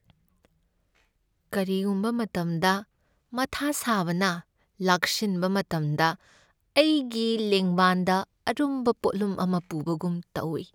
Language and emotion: Manipuri, sad